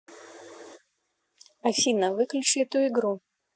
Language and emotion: Russian, neutral